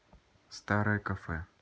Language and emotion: Russian, neutral